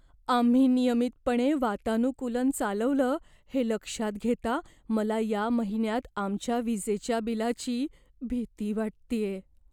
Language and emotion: Marathi, fearful